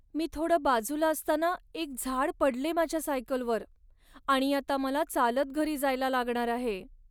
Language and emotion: Marathi, sad